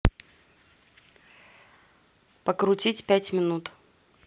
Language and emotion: Russian, neutral